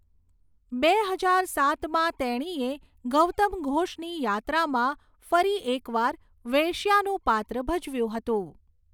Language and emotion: Gujarati, neutral